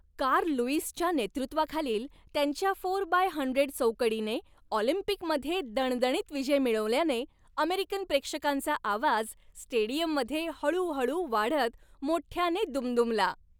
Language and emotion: Marathi, happy